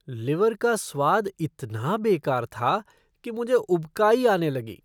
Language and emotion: Hindi, disgusted